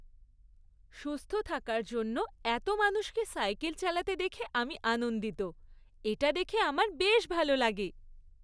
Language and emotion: Bengali, happy